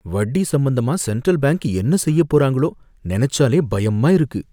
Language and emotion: Tamil, fearful